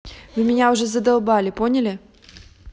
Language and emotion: Russian, angry